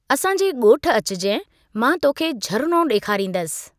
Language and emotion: Sindhi, neutral